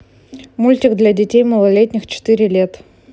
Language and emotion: Russian, neutral